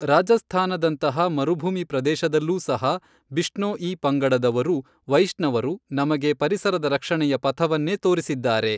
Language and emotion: Kannada, neutral